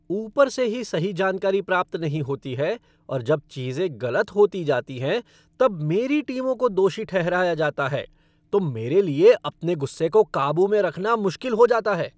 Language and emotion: Hindi, angry